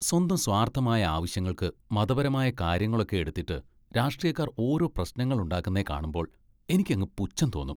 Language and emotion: Malayalam, disgusted